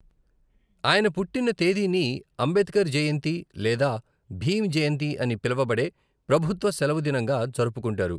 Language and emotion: Telugu, neutral